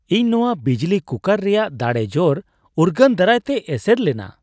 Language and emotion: Santali, surprised